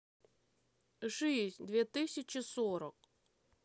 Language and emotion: Russian, neutral